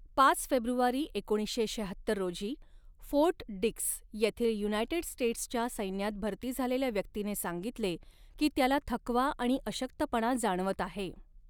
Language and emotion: Marathi, neutral